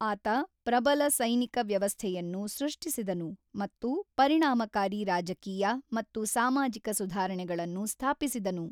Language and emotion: Kannada, neutral